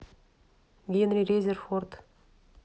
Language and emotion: Russian, neutral